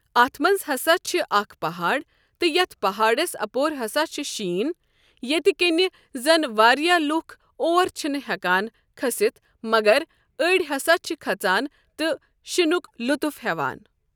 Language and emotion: Kashmiri, neutral